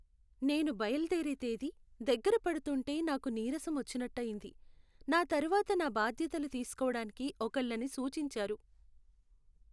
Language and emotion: Telugu, sad